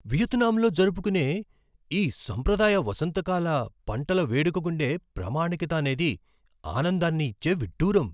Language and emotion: Telugu, surprised